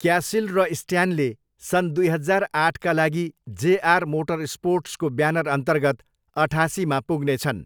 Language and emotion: Nepali, neutral